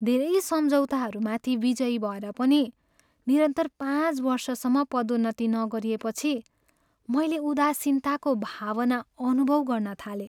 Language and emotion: Nepali, sad